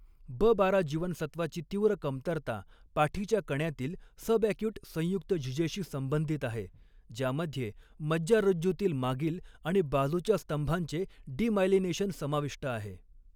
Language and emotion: Marathi, neutral